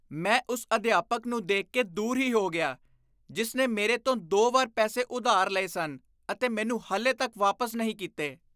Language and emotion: Punjabi, disgusted